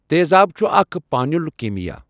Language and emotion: Kashmiri, neutral